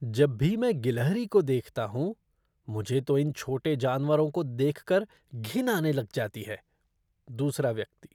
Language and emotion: Hindi, disgusted